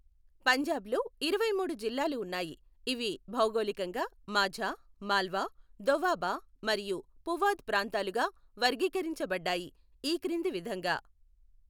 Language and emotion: Telugu, neutral